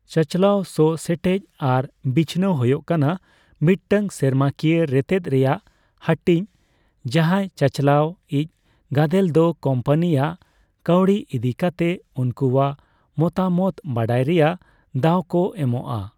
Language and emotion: Santali, neutral